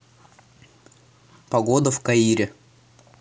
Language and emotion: Russian, neutral